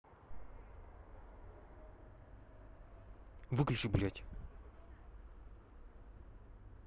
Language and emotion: Russian, angry